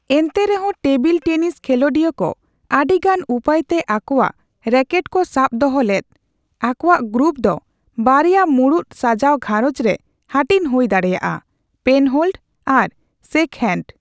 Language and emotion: Santali, neutral